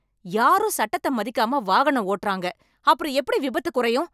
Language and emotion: Tamil, angry